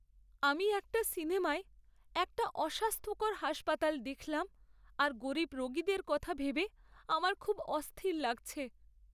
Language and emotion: Bengali, sad